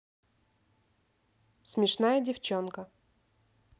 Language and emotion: Russian, neutral